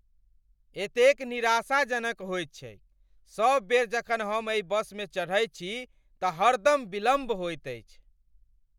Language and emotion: Maithili, angry